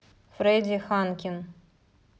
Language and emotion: Russian, neutral